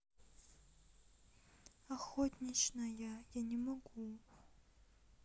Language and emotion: Russian, sad